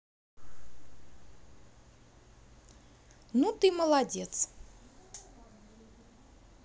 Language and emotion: Russian, positive